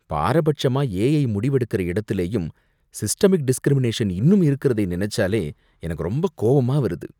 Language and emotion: Tamil, disgusted